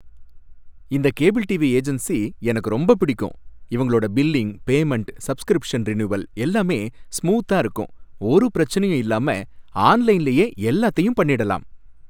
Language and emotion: Tamil, happy